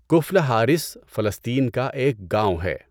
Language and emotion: Urdu, neutral